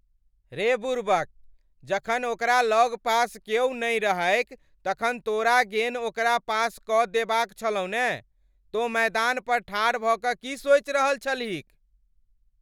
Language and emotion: Maithili, angry